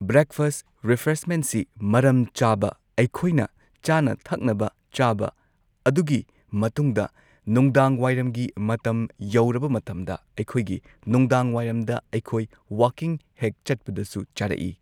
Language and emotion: Manipuri, neutral